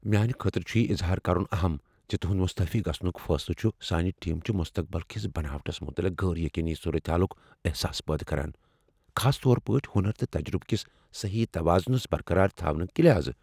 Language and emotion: Kashmiri, fearful